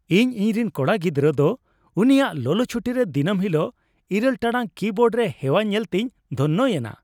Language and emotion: Santali, happy